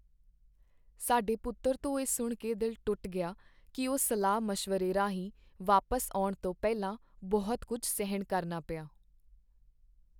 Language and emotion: Punjabi, sad